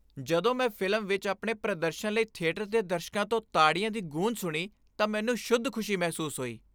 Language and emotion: Punjabi, happy